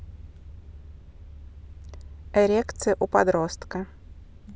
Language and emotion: Russian, neutral